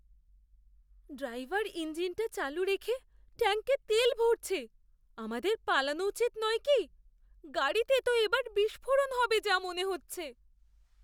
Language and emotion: Bengali, fearful